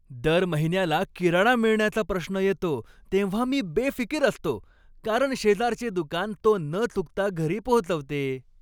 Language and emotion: Marathi, happy